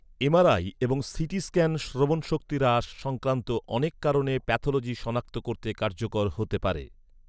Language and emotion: Bengali, neutral